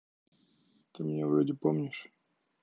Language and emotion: Russian, neutral